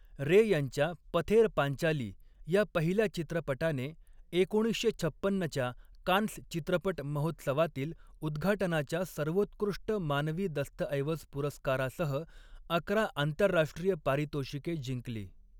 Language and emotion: Marathi, neutral